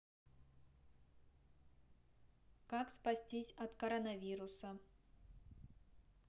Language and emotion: Russian, neutral